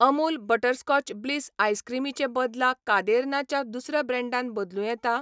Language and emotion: Goan Konkani, neutral